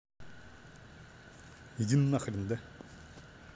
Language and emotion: Russian, angry